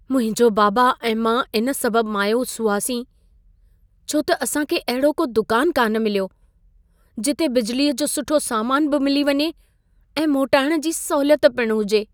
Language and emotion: Sindhi, sad